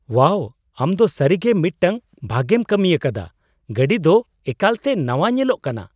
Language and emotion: Santali, surprised